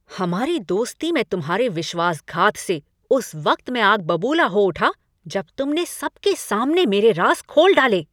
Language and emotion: Hindi, angry